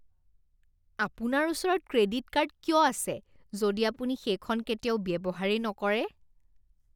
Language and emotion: Assamese, disgusted